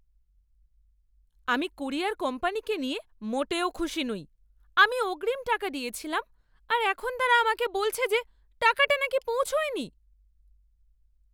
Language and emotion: Bengali, angry